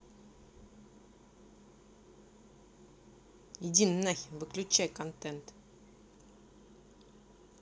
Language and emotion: Russian, angry